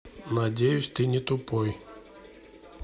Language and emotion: Russian, neutral